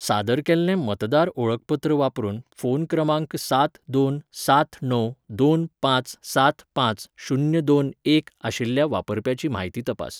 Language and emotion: Goan Konkani, neutral